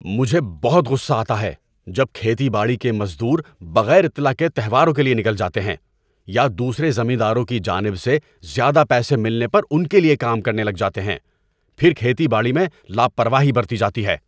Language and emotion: Urdu, angry